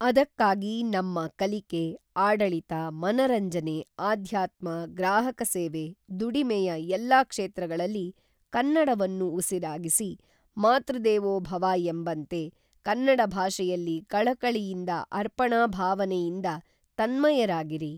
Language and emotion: Kannada, neutral